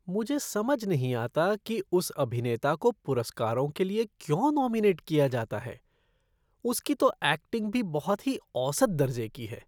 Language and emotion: Hindi, disgusted